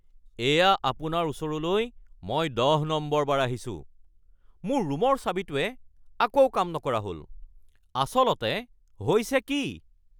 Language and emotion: Assamese, angry